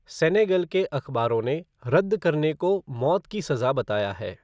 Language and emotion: Hindi, neutral